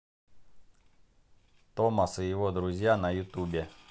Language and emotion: Russian, neutral